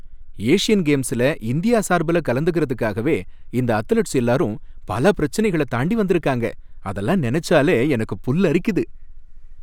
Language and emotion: Tamil, happy